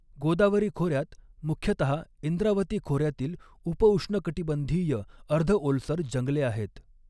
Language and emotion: Marathi, neutral